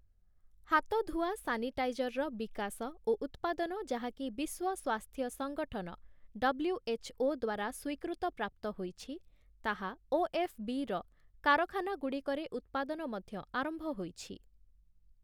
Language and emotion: Odia, neutral